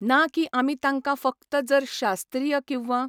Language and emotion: Goan Konkani, neutral